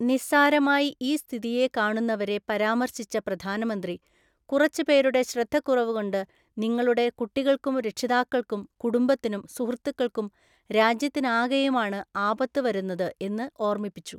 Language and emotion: Malayalam, neutral